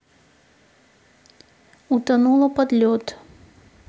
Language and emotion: Russian, neutral